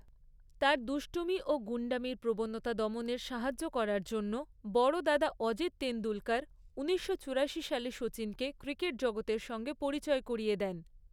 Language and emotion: Bengali, neutral